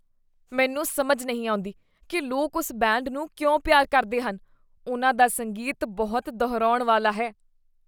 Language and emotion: Punjabi, disgusted